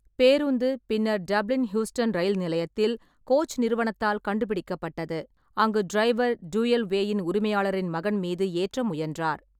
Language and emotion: Tamil, neutral